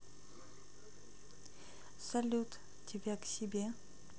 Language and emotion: Russian, neutral